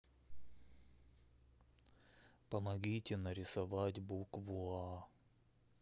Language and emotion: Russian, sad